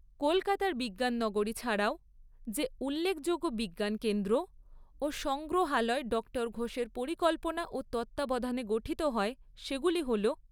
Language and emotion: Bengali, neutral